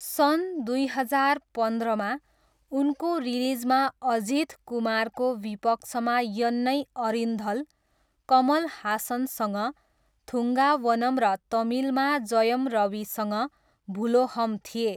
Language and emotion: Nepali, neutral